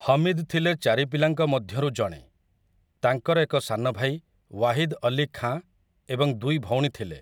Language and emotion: Odia, neutral